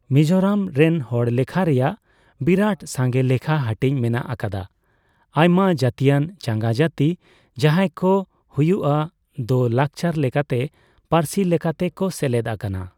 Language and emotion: Santali, neutral